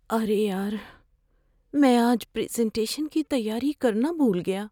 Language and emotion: Urdu, fearful